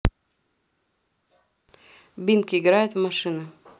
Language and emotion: Russian, neutral